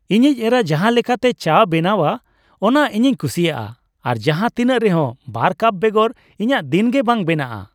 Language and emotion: Santali, happy